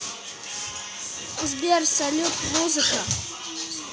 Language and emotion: Russian, neutral